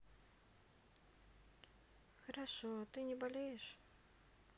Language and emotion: Russian, neutral